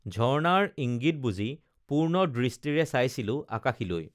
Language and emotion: Assamese, neutral